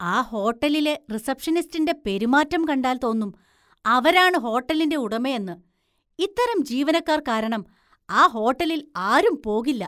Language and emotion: Malayalam, disgusted